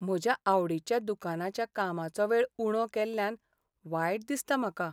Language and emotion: Goan Konkani, sad